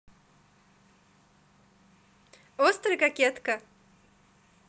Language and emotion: Russian, positive